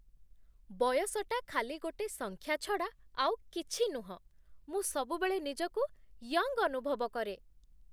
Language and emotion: Odia, happy